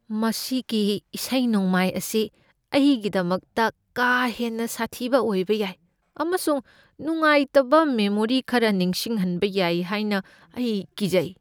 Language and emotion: Manipuri, fearful